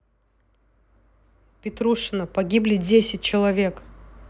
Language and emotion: Russian, angry